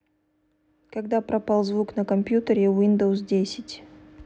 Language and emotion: Russian, neutral